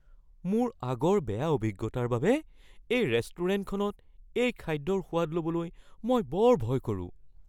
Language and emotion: Assamese, fearful